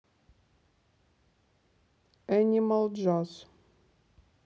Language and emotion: Russian, neutral